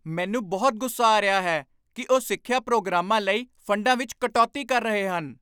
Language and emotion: Punjabi, angry